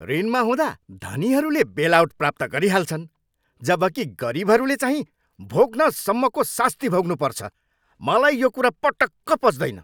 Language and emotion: Nepali, angry